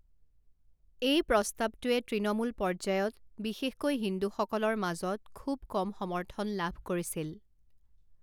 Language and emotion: Assamese, neutral